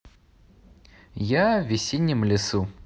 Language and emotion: Russian, positive